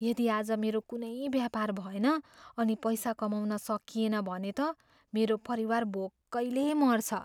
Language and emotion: Nepali, fearful